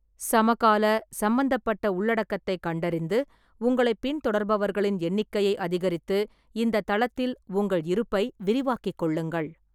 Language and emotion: Tamil, neutral